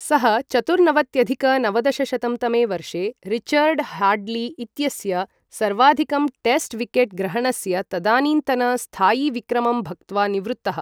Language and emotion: Sanskrit, neutral